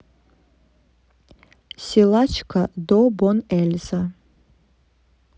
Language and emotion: Russian, neutral